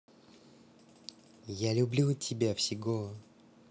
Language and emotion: Russian, positive